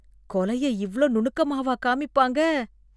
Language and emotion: Tamil, disgusted